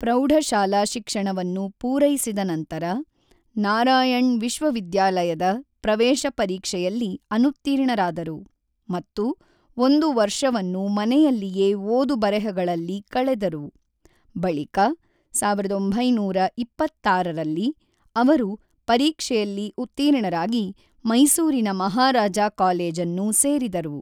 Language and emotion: Kannada, neutral